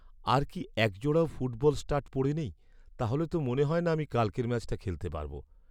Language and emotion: Bengali, sad